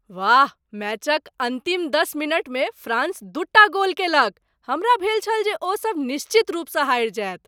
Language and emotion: Maithili, surprised